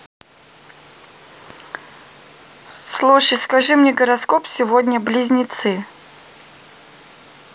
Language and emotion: Russian, neutral